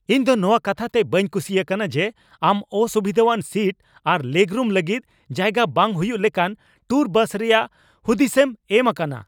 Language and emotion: Santali, angry